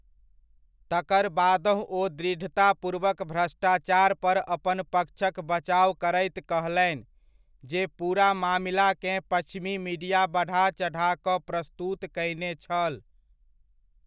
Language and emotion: Maithili, neutral